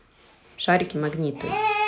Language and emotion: Russian, neutral